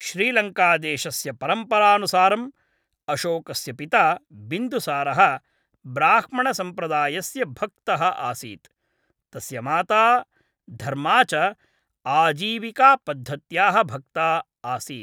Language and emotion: Sanskrit, neutral